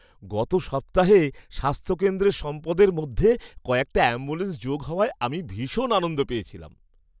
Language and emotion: Bengali, happy